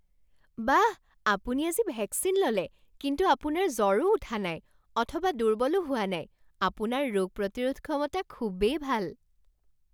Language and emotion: Assamese, surprised